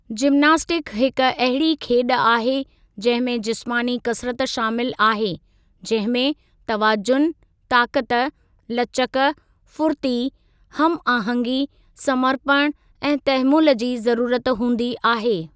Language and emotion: Sindhi, neutral